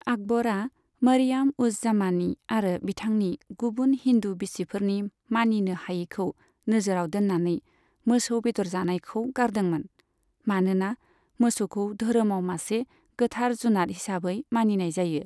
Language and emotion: Bodo, neutral